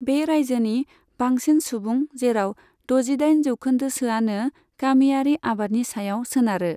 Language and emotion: Bodo, neutral